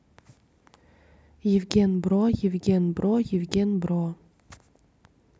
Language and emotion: Russian, neutral